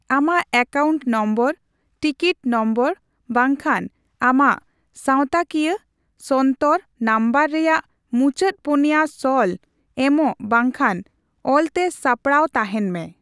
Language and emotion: Santali, neutral